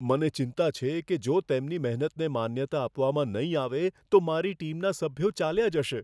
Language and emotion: Gujarati, fearful